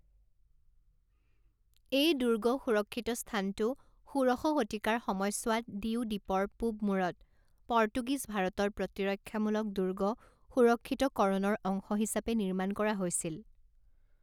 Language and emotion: Assamese, neutral